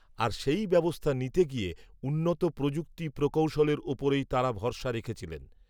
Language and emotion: Bengali, neutral